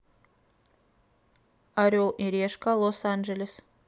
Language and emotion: Russian, neutral